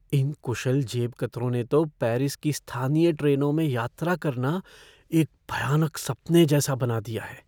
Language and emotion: Hindi, fearful